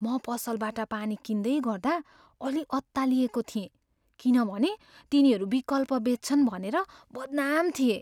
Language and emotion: Nepali, fearful